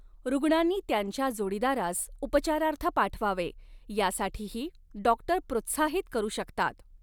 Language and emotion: Marathi, neutral